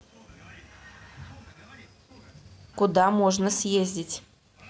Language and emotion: Russian, neutral